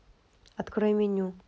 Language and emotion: Russian, neutral